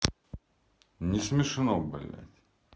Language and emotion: Russian, angry